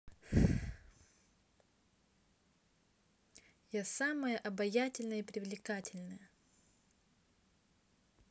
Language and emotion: Russian, neutral